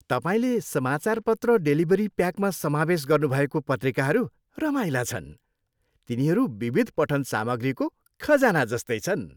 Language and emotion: Nepali, happy